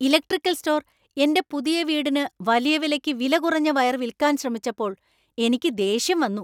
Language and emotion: Malayalam, angry